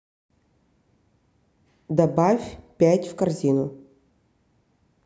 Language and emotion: Russian, neutral